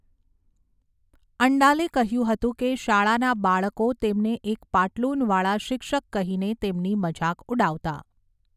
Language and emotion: Gujarati, neutral